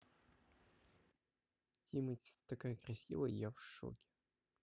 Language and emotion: Russian, neutral